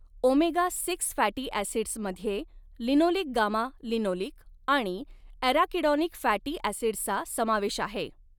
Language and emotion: Marathi, neutral